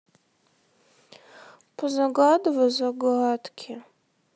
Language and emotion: Russian, sad